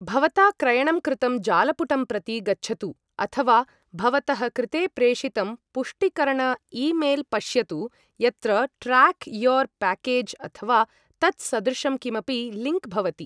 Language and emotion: Sanskrit, neutral